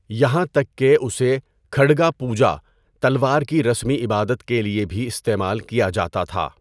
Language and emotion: Urdu, neutral